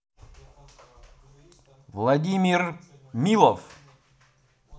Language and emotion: Russian, positive